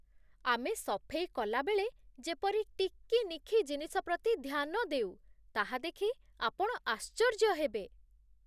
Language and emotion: Odia, surprised